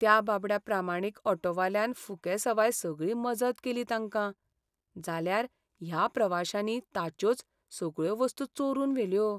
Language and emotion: Goan Konkani, sad